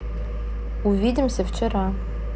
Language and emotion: Russian, neutral